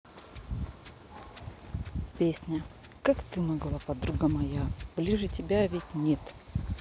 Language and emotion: Russian, neutral